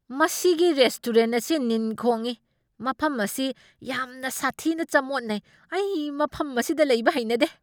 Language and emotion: Manipuri, angry